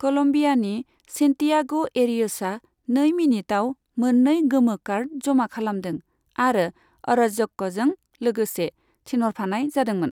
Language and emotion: Bodo, neutral